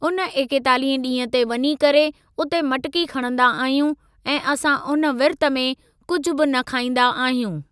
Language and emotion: Sindhi, neutral